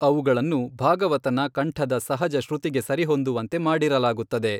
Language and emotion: Kannada, neutral